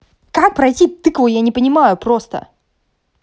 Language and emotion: Russian, angry